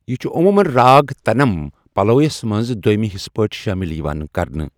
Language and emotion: Kashmiri, neutral